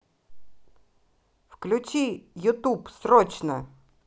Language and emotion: Russian, angry